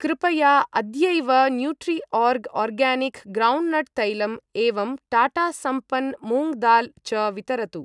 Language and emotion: Sanskrit, neutral